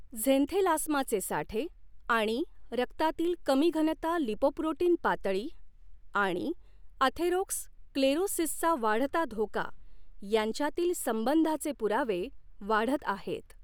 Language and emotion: Marathi, neutral